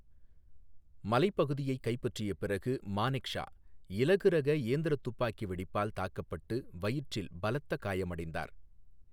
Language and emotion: Tamil, neutral